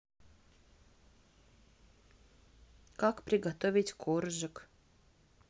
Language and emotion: Russian, neutral